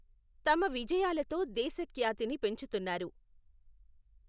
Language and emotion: Telugu, neutral